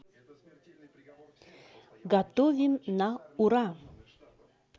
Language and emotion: Russian, positive